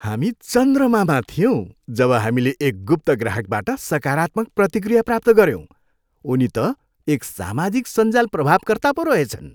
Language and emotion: Nepali, happy